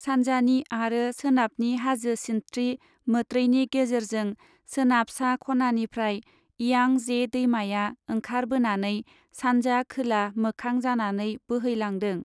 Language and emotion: Bodo, neutral